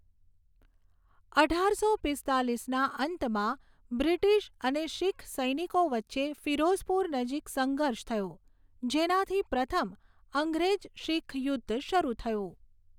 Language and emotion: Gujarati, neutral